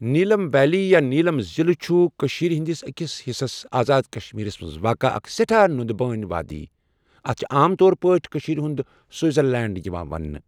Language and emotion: Kashmiri, neutral